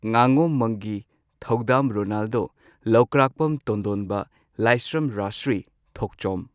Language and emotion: Manipuri, neutral